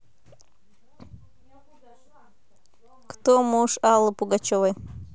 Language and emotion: Russian, neutral